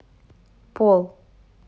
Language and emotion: Russian, neutral